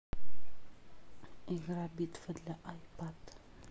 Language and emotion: Russian, neutral